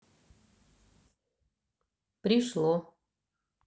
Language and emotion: Russian, neutral